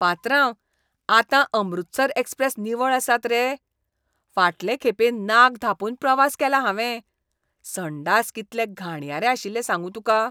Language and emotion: Goan Konkani, disgusted